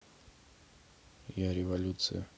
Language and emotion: Russian, neutral